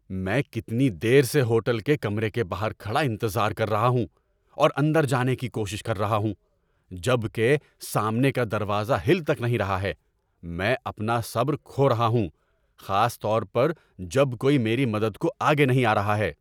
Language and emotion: Urdu, angry